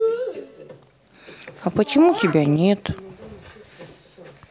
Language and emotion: Russian, sad